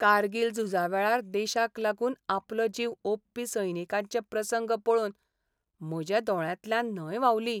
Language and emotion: Goan Konkani, sad